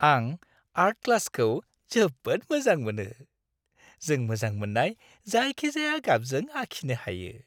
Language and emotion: Bodo, happy